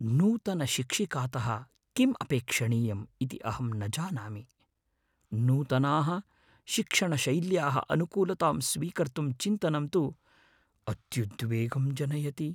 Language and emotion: Sanskrit, fearful